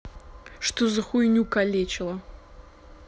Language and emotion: Russian, angry